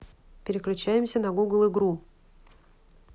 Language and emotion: Russian, neutral